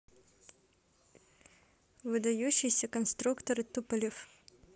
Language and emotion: Russian, neutral